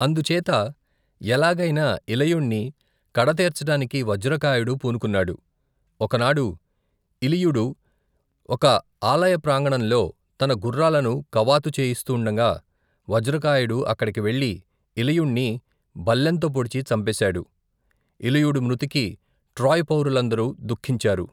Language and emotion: Telugu, neutral